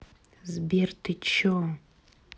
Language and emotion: Russian, angry